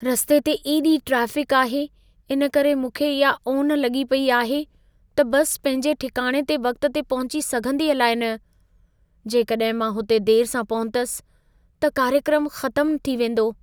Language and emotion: Sindhi, fearful